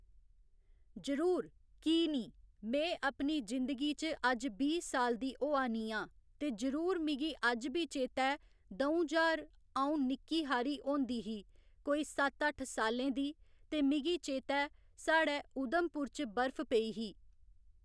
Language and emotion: Dogri, neutral